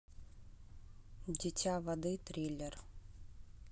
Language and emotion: Russian, neutral